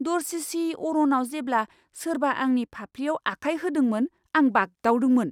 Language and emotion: Bodo, surprised